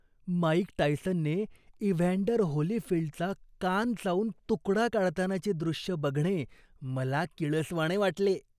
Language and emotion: Marathi, disgusted